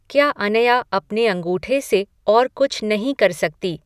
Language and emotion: Hindi, neutral